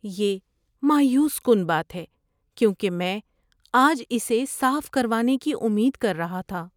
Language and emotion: Urdu, sad